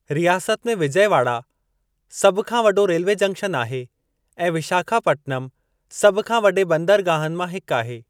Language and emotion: Sindhi, neutral